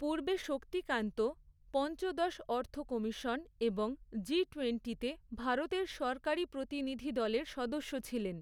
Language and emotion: Bengali, neutral